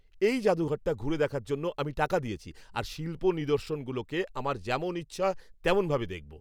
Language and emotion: Bengali, angry